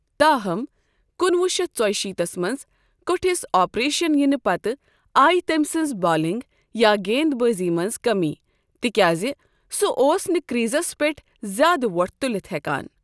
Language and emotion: Kashmiri, neutral